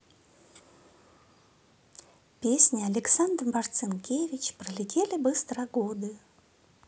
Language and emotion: Russian, positive